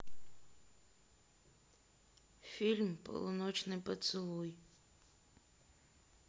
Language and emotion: Russian, sad